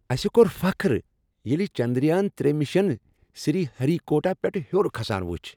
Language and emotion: Kashmiri, happy